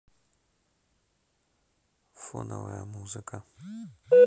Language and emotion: Russian, neutral